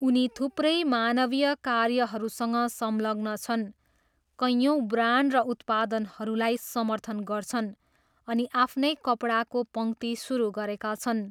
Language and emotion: Nepali, neutral